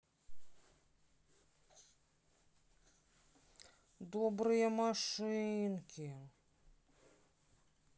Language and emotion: Russian, sad